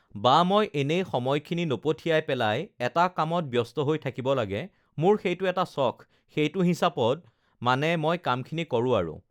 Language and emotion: Assamese, neutral